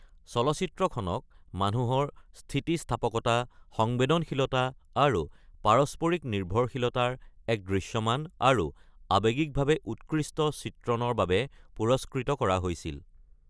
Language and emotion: Assamese, neutral